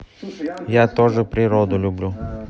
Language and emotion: Russian, neutral